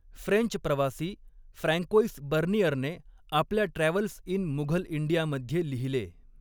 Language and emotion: Marathi, neutral